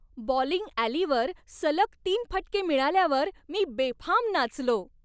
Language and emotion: Marathi, happy